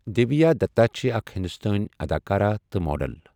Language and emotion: Kashmiri, neutral